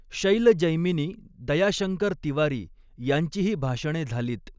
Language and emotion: Marathi, neutral